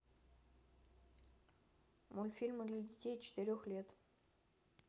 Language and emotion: Russian, neutral